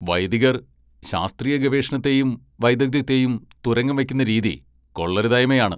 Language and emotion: Malayalam, angry